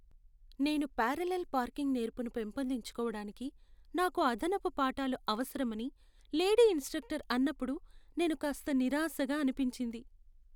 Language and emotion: Telugu, sad